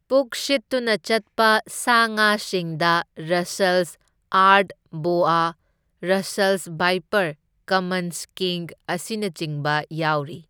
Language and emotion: Manipuri, neutral